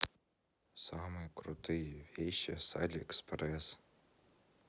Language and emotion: Russian, neutral